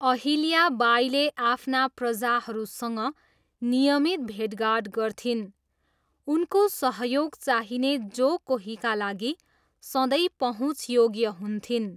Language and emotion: Nepali, neutral